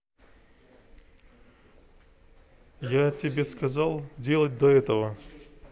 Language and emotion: Russian, neutral